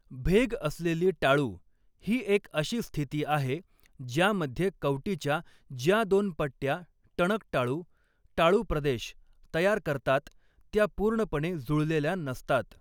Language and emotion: Marathi, neutral